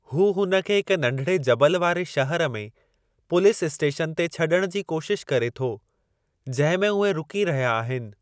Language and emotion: Sindhi, neutral